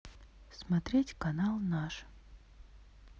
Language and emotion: Russian, neutral